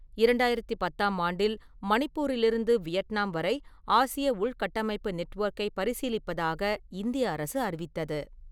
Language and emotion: Tamil, neutral